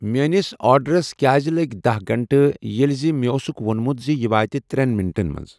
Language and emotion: Kashmiri, neutral